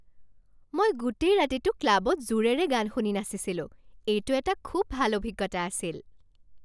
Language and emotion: Assamese, happy